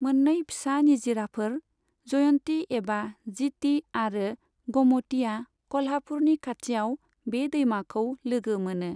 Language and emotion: Bodo, neutral